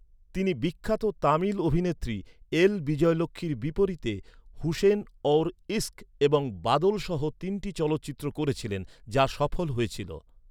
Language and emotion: Bengali, neutral